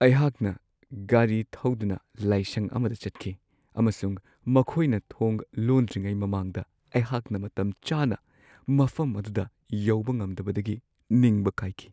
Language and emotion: Manipuri, sad